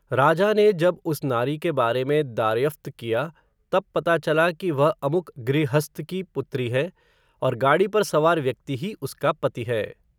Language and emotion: Hindi, neutral